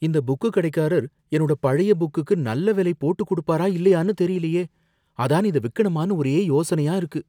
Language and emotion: Tamil, fearful